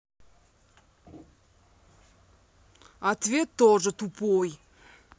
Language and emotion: Russian, angry